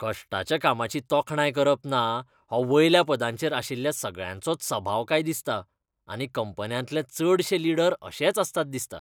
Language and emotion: Goan Konkani, disgusted